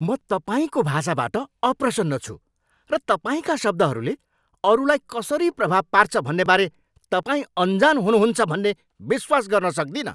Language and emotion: Nepali, angry